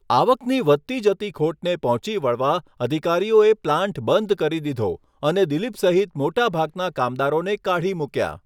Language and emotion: Gujarati, neutral